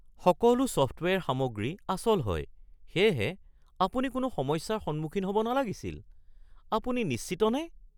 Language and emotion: Assamese, surprised